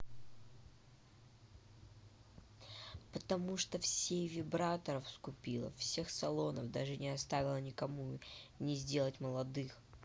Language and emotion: Russian, neutral